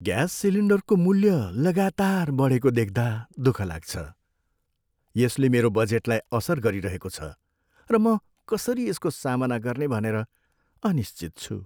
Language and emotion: Nepali, sad